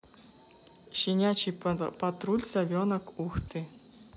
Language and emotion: Russian, neutral